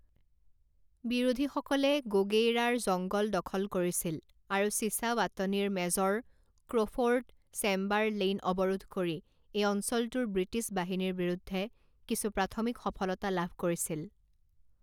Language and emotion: Assamese, neutral